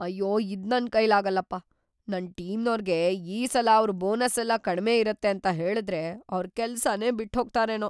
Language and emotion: Kannada, fearful